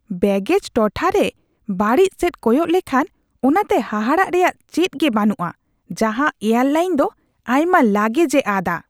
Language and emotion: Santali, disgusted